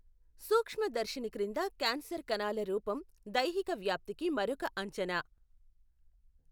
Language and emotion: Telugu, neutral